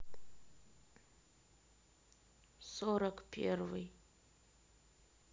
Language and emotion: Russian, sad